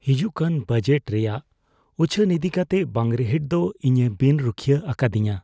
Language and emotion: Santali, fearful